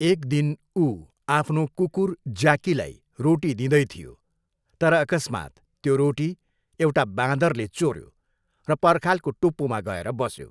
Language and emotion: Nepali, neutral